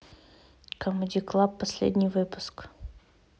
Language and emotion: Russian, neutral